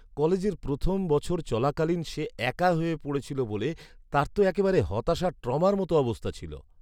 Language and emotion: Bengali, sad